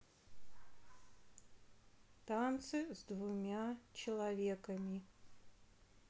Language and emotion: Russian, neutral